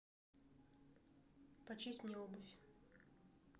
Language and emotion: Russian, neutral